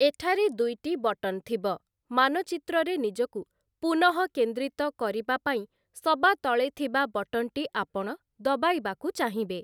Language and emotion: Odia, neutral